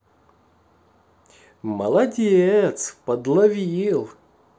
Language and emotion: Russian, positive